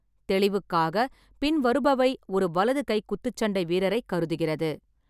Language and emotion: Tamil, neutral